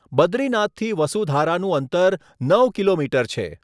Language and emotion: Gujarati, neutral